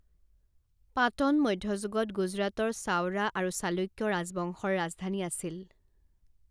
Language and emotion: Assamese, neutral